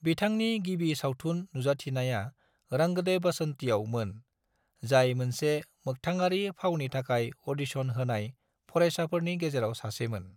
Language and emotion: Bodo, neutral